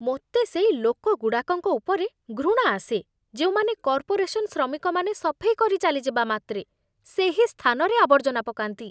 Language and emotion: Odia, disgusted